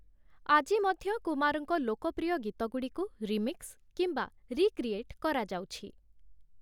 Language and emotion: Odia, neutral